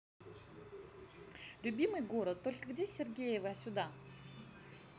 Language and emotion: Russian, positive